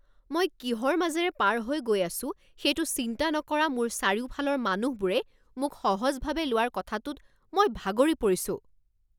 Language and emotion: Assamese, angry